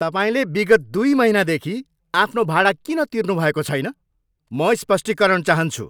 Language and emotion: Nepali, angry